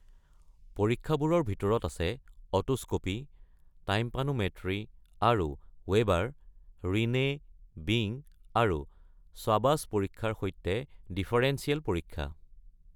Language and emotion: Assamese, neutral